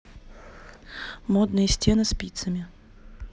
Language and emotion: Russian, neutral